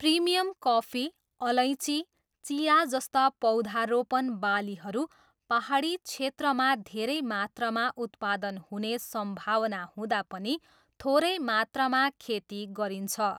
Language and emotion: Nepali, neutral